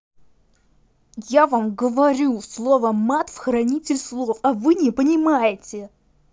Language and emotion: Russian, angry